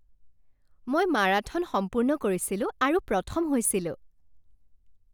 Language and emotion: Assamese, happy